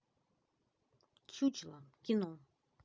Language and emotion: Russian, neutral